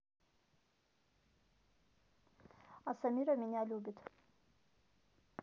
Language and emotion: Russian, neutral